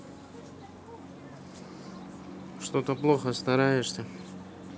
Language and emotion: Russian, neutral